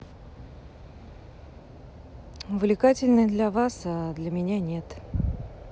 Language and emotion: Russian, neutral